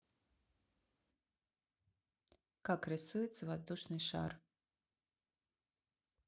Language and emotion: Russian, neutral